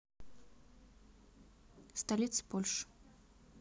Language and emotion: Russian, neutral